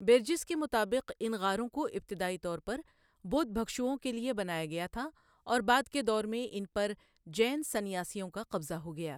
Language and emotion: Urdu, neutral